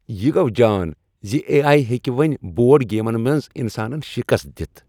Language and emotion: Kashmiri, happy